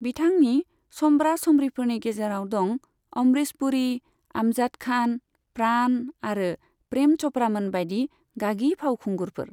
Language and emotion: Bodo, neutral